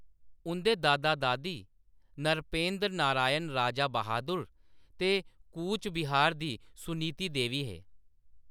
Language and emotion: Dogri, neutral